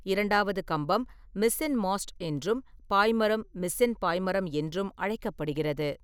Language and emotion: Tamil, neutral